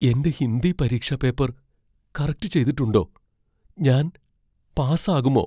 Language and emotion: Malayalam, fearful